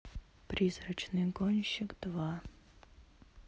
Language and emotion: Russian, neutral